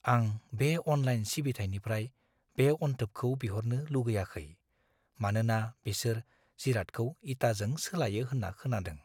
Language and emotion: Bodo, fearful